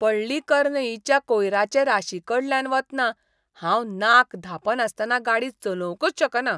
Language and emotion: Goan Konkani, disgusted